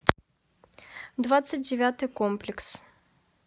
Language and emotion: Russian, neutral